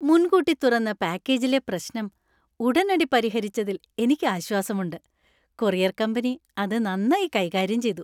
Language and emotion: Malayalam, happy